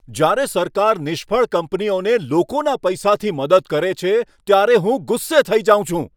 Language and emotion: Gujarati, angry